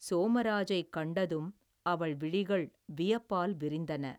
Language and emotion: Tamil, neutral